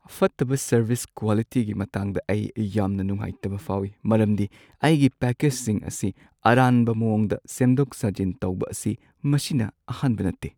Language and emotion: Manipuri, sad